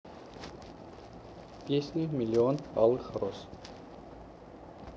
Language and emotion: Russian, neutral